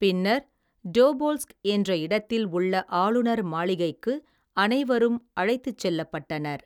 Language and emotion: Tamil, neutral